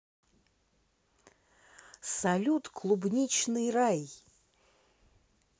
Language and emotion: Russian, positive